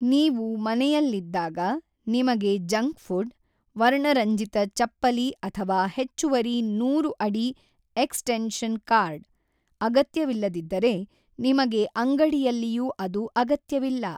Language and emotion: Kannada, neutral